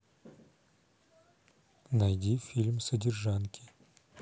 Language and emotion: Russian, neutral